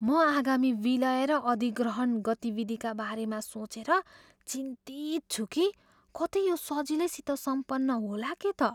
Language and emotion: Nepali, fearful